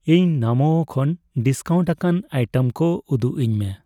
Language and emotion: Santali, neutral